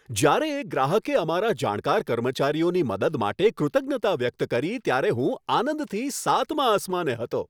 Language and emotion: Gujarati, happy